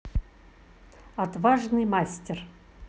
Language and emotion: Russian, positive